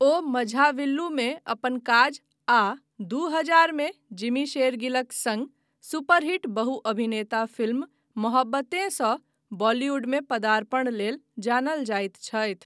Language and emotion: Maithili, neutral